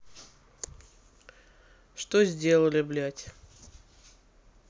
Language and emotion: Russian, neutral